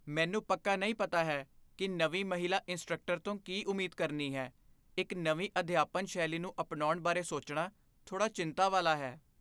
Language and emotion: Punjabi, fearful